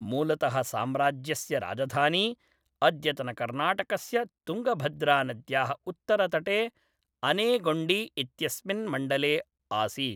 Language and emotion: Sanskrit, neutral